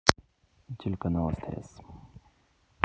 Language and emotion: Russian, neutral